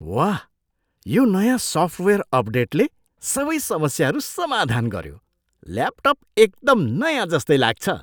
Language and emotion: Nepali, surprised